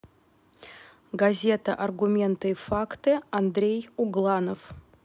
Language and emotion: Russian, neutral